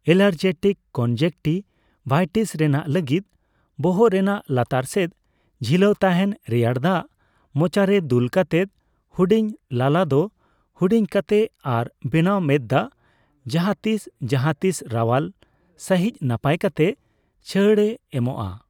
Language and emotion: Santali, neutral